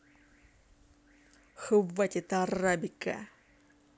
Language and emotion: Russian, angry